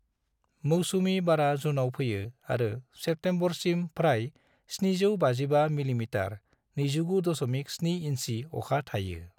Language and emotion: Bodo, neutral